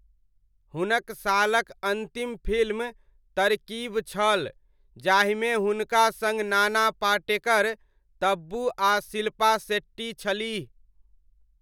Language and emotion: Maithili, neutral